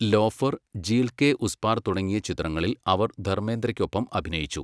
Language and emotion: Malayalam, neutral